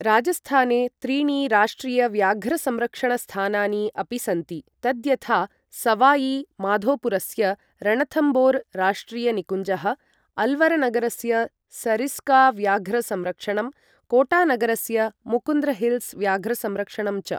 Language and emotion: Sanskrit, neutral